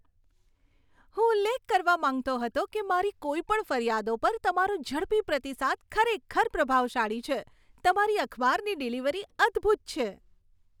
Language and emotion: Gujarati, happy